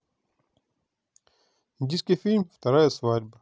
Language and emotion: Russian, neutral